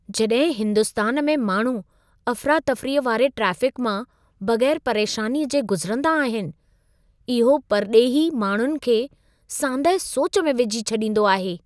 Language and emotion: Sindhi, surprised